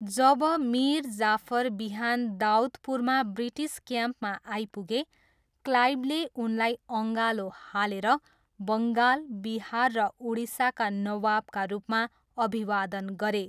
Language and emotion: Nepali, neutral